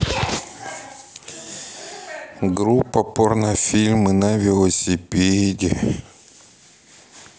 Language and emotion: Russian, sad